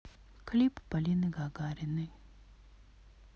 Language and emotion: Russian, sad